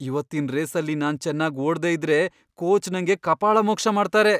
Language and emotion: Kannada, fearful